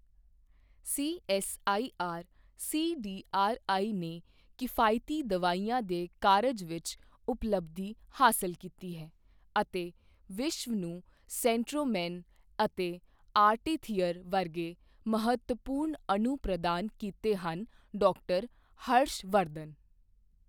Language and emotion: Punjabi, neutral